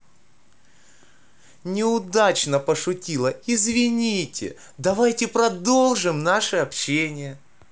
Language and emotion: Russian, positive